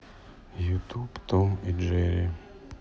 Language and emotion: Russian, sad